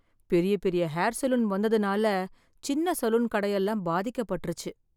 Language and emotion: Tamil, sad